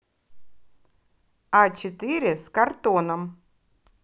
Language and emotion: Russian, positive